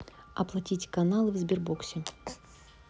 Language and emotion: Russian, neutral